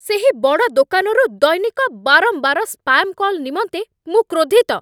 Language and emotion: Odia, angry